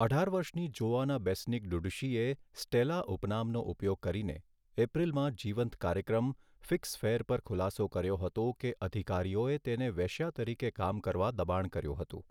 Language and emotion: Gujarati, neutral